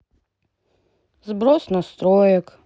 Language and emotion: Russian, sad